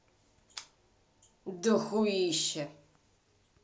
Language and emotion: Russian, angry